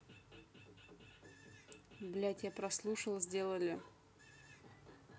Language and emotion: Russian, neutral